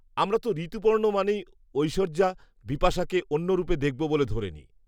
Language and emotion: Bengali, neutral